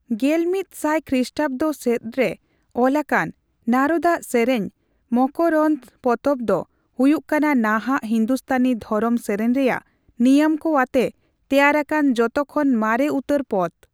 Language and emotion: Santali, neutral